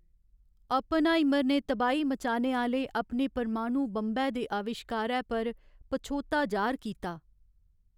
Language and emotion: Dogri, sad